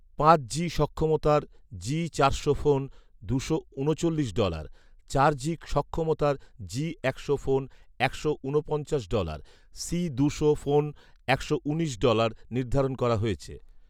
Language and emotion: Bengali, neutral